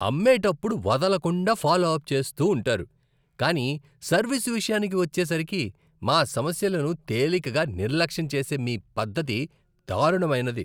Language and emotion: Telugu, disgusted